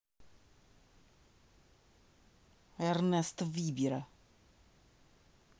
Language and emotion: Russian, angry